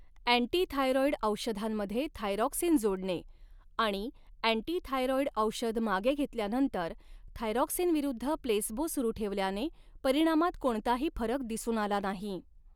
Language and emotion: Marathi, neutral